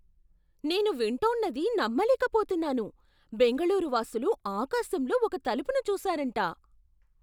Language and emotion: Telugu, surprised